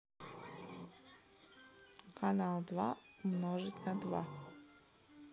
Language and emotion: Russian, neutral